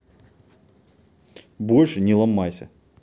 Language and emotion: Russian, angry